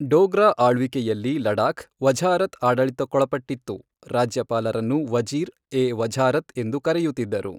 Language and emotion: Kannada, neutral